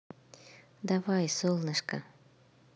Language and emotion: Russian, positive